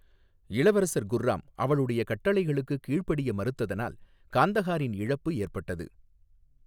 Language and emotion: Tamil, neutral